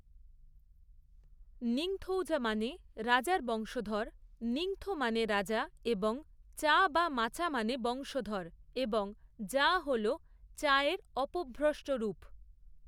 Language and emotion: Bengali, neutral